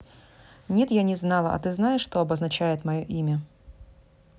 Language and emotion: Russian, neutral